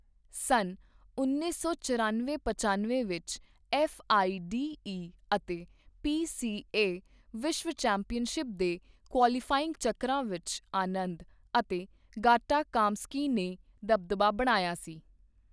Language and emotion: Punjabi, neutral